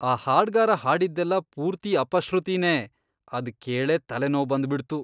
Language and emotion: Kannada, disgusted